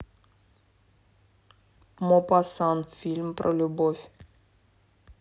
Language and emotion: Russian, neutral